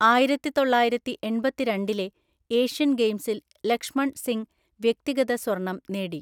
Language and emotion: Malayalam, neutral